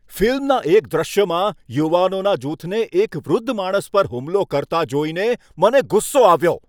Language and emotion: Gujarati, angry